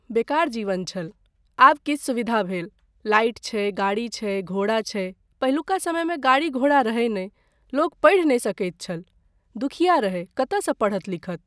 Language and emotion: Maithili, neutral